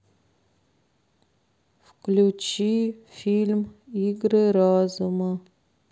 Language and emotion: Russian, sad